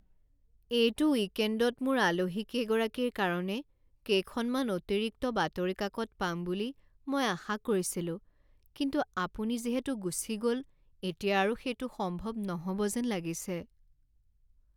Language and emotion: Assamese, sad